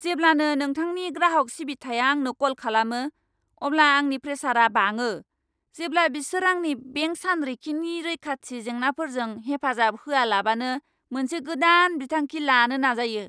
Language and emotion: Bodo, angry